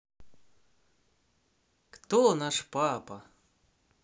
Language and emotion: Russian, positive